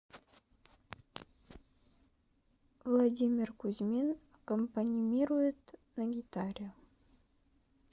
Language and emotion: Russian, neutral